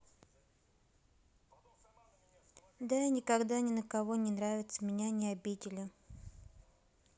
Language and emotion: Russian, sad